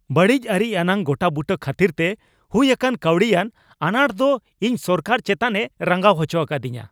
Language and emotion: Santali, angry